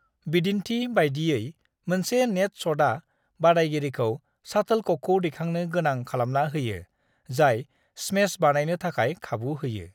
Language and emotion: Bodo, neutral